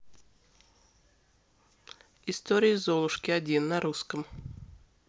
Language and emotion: Russian, neutral